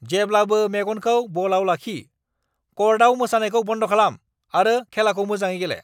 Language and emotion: Bodo, angry